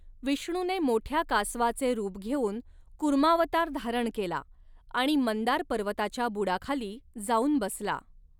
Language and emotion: Marathi, neutral